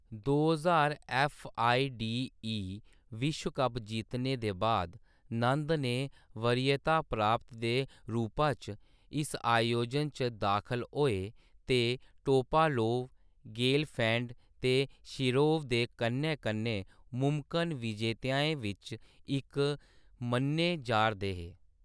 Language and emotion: Dogri, neutral